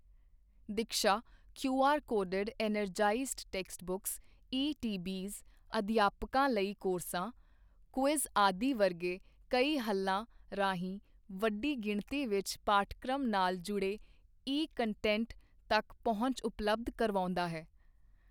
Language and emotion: Punjabi, neutral